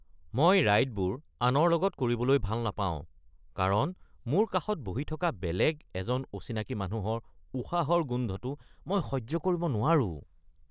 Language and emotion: Assamese, disgusted